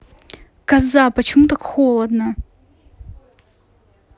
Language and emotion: Russian, angry